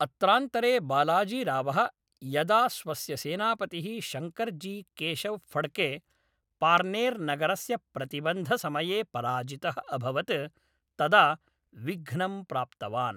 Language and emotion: Sanskrit, neutral